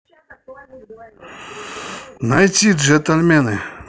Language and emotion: Russian, neutral